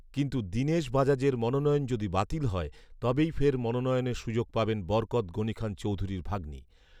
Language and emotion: Bengali, neutral